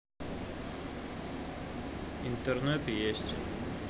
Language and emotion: Russian, neutral